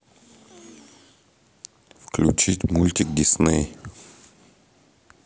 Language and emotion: Russian, neutral